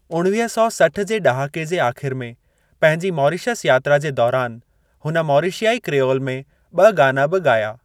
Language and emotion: Sindhi, neutral